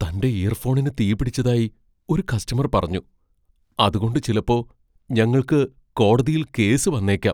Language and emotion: Malayalam, fearful